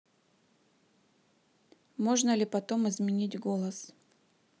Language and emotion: Russian, neutral